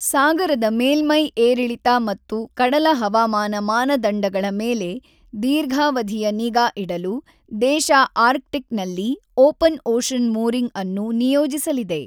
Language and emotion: Kannada, neutral